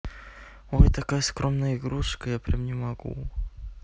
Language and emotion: Russian, neutral